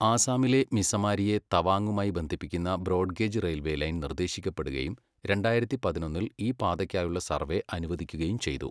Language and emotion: Malayalam, neutral